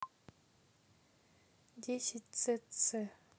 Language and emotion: Russian, neutral